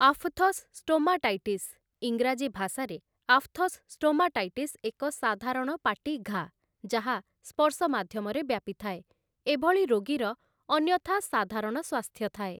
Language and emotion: Odia, neutral